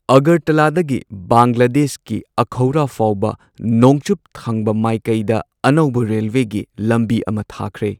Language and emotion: Manipuri, neutral